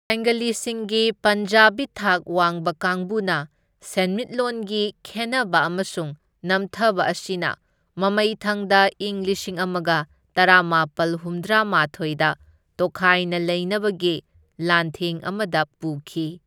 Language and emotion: Manipuri, neutral